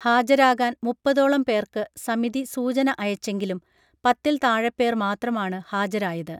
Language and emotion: Malayalam, neutral